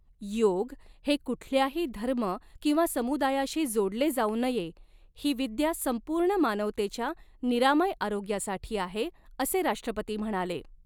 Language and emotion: Marathi, neutral